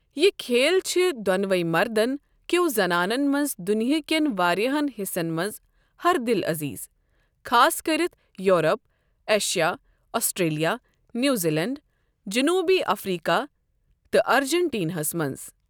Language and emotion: Kashmiri, neutral